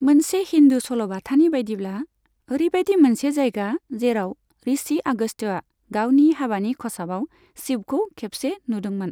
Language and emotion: Bodo, neutral